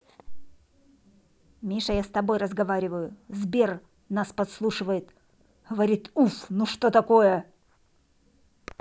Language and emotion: Russian, angry